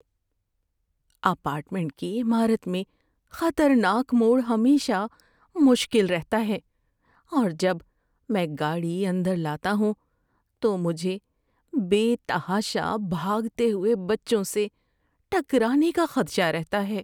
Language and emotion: Urdu, fearful